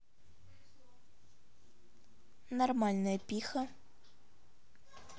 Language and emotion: Russian, neutral